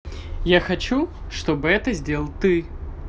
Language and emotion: Russian, positive